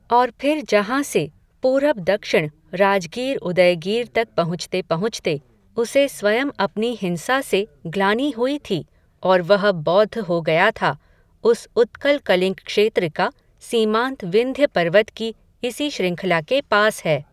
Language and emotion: Hindi, neutral